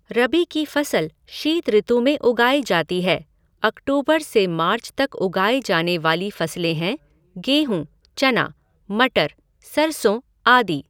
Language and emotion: Hindi, neutral